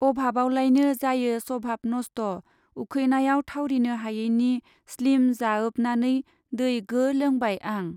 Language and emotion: Bodo, neutral